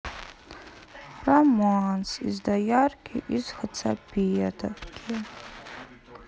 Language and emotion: Russian, sad